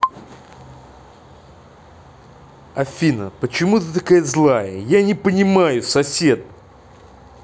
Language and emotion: Russian, angry